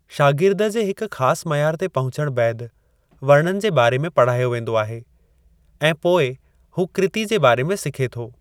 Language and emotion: Sindhi, neutral